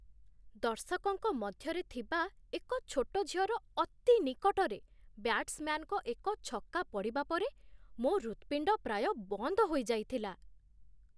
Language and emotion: Odia, surprised